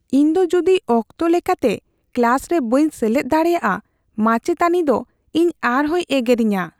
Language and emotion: Santali, fearful